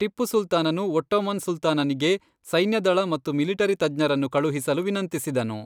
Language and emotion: Kannada, neutral